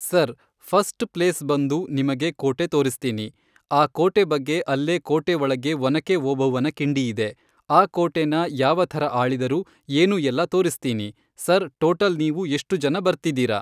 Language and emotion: Kannada, neutral